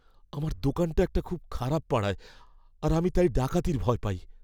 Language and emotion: Bengali, fearful